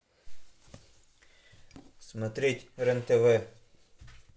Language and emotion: Russian, neutral